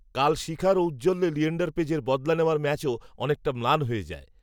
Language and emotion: Bengali, neutral